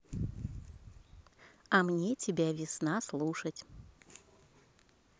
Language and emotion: Russian, positive